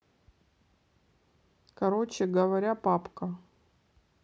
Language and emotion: Russian, neutral